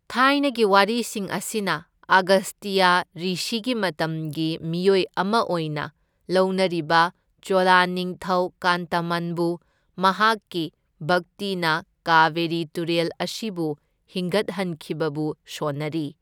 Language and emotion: Manipuri, neutral